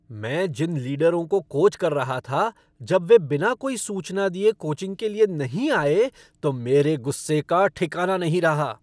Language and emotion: Hindi, angry